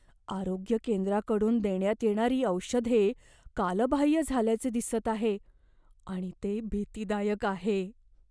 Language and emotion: Marathi, fearful